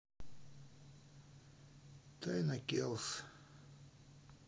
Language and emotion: Russian, sad